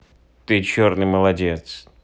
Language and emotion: Russian, neutral